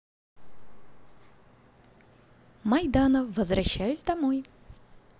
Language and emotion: Russian, positive